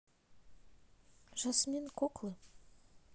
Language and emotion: Russian, neutral